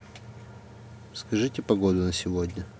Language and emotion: Russian, neutral